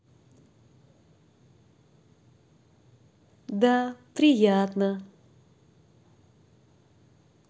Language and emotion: Russian, positive